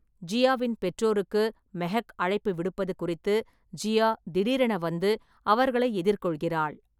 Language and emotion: Tamil, neutral